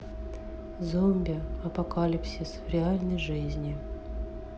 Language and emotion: Russian, neutral